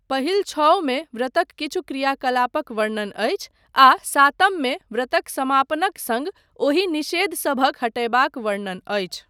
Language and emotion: Maithili, neutral